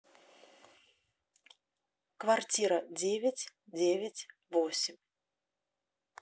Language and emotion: Russian, neutral